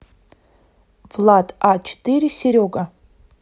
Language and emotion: Russian, neutral